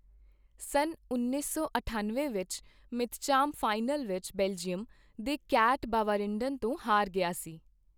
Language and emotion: Punjabi, neutral